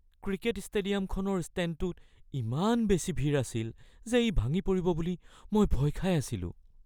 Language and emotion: Assamese, fearful